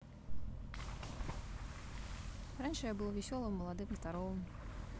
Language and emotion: Russian, neutral